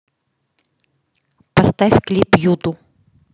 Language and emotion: Russian, neutral